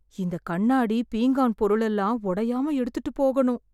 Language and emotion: Tamil, fearful